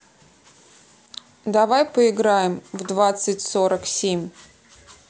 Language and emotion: Russian, neutral